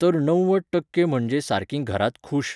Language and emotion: Goan Konkani, neutral